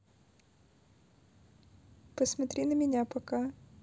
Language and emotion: Russian, neutral